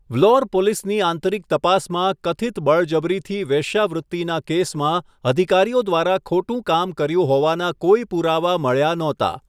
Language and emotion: Gujarati, neutral